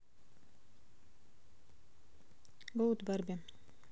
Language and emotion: Russian, neutral